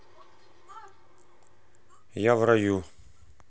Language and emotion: Russian, neutral